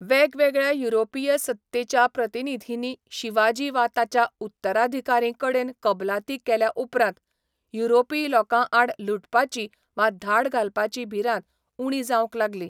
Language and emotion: Goan Konkani, neutral